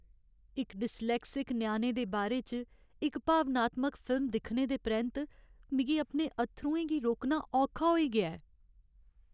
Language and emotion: Dogri, sad